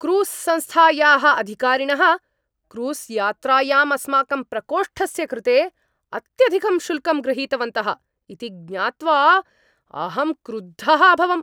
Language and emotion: Sanskrit, angry